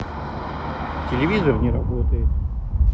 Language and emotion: Russian, neutral